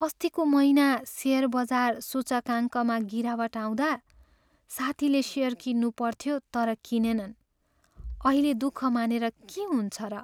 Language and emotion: Nepali, sad